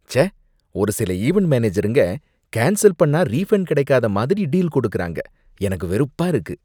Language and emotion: Tamil, disgusted